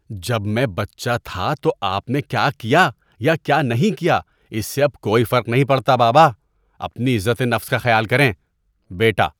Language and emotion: Urdu, disgusted